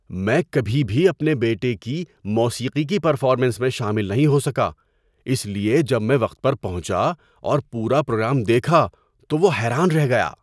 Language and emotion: Urdu, surprised